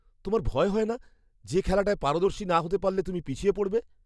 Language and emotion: Bengali, fearful